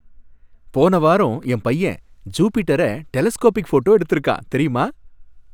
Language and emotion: Tamil, happy